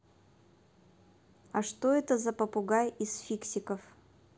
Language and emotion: Russian, neutral